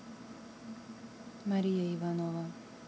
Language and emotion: Russian, neutral